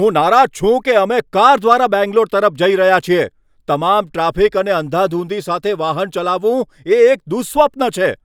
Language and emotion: Gujarati, angry